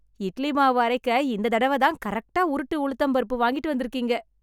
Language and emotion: Tamil, happy